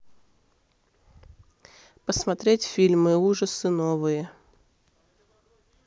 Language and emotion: Russian, neutral